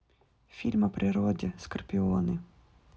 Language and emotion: Russian, neutral